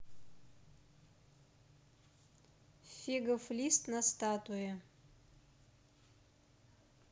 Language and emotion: Russian, neutral